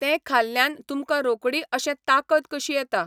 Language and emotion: Goan Konkani, neutral